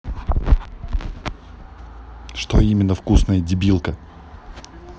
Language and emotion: Russian, angry